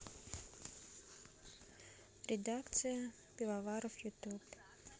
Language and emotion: Russian, neutral